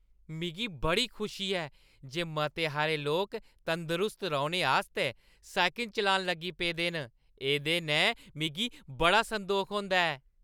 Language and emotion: Dogri, happy